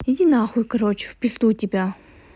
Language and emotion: Russian, angry